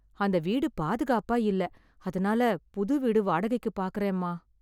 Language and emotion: Tamil, sad